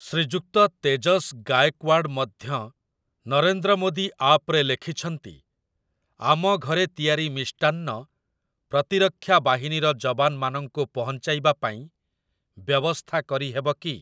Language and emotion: Odia, neutral